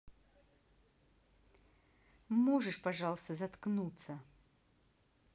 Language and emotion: Russian, angry